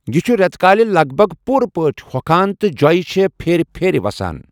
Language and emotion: Kashmiri, neutral